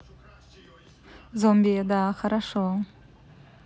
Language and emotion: Russian, neutral